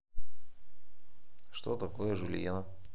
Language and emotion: Russian, neutral